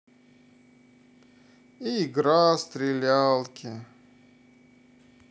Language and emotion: Russian, sad